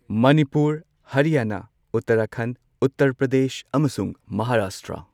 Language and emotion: Manipuri, neutral